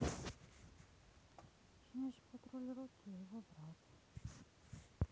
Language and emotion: Russian, sad